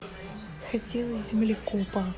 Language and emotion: Russian, neutral